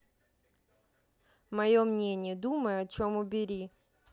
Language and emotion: Russian, neutral